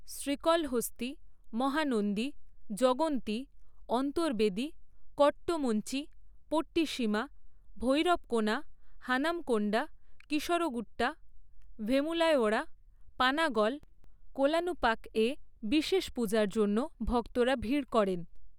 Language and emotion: Bengali, neutral